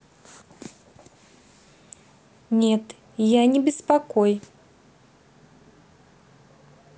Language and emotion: Russian, neutral